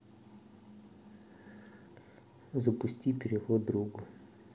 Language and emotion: Russian, neutral